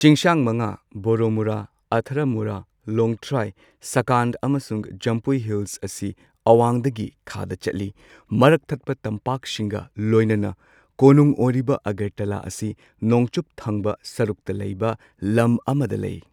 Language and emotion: Manipuri, neutral